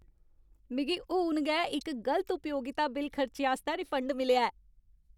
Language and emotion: Dogri, happy